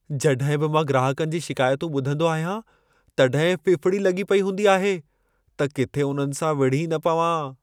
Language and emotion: Sindhi, fearful